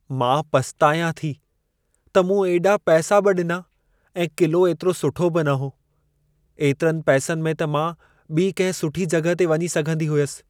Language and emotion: Sindhi, sad